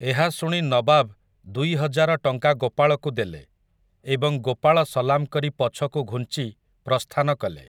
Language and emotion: Odia, neutral